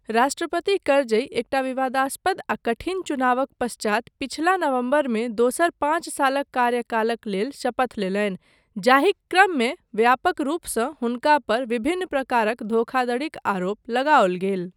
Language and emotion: Maithili, neutral